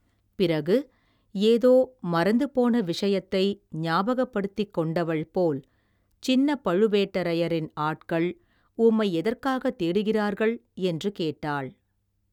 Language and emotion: Tamil, neutral